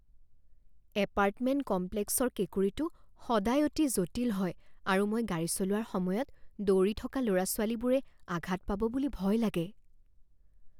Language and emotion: Assamese, fearful